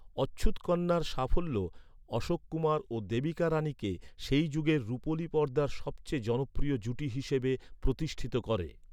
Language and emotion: Bengali, neutral